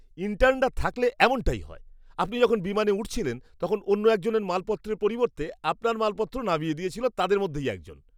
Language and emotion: Bengali, disgusted